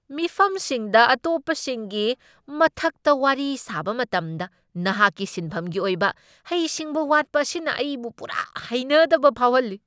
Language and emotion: Manipuri, angry